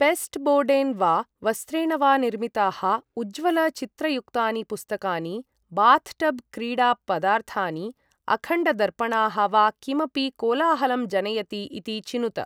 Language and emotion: Sanskrit, neutral